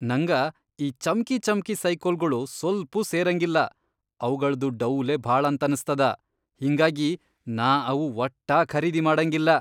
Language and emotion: Kannada, disgusted